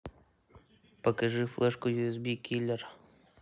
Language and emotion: Russian, neutral